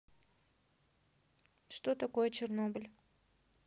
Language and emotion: Russian, neutral